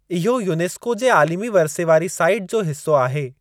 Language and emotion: Sindhi, neutral